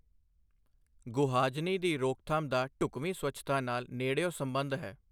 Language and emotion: Punjabi, neutral